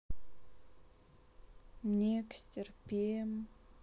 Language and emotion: Russian, sad